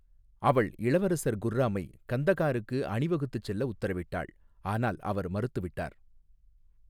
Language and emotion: Tamil, neutral